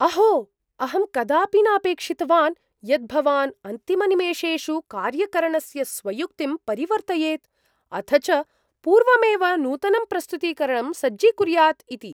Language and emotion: Sanskrit, surprised